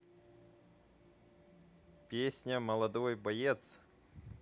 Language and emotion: Russian, neutral